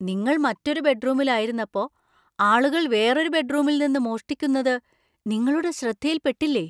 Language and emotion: Malayalam, surprised